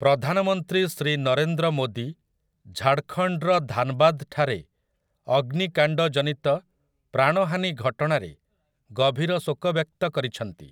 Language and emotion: Odia, neutral